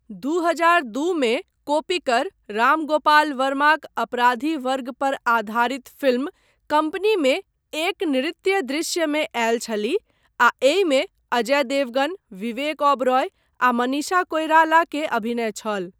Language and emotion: Maithili, neutral